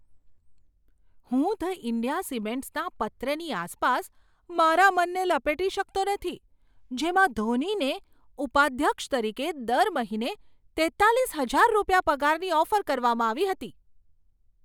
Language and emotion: Gujarati, surprised